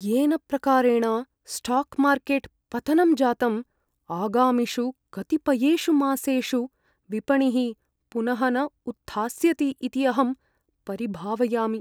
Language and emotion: Sanskrit, fearful